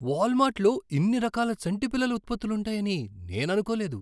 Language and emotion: Telugu, surprised